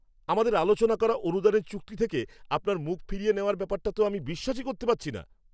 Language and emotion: Bengali, angry